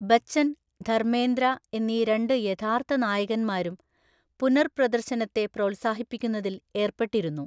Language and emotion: Malayalam, neutral